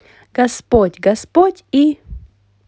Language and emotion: Russian, positive